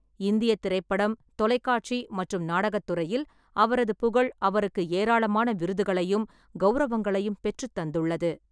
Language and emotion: Tamil, neutral